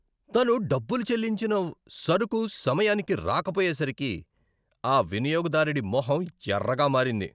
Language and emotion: Telugu, angry